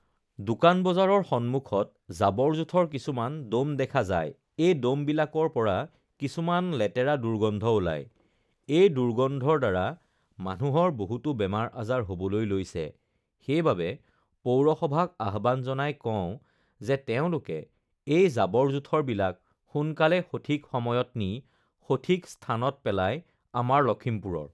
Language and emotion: Assamese, neutral